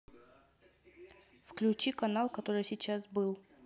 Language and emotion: Russian, neutral